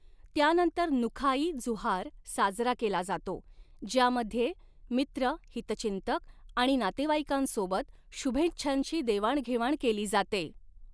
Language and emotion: Marathi, neutral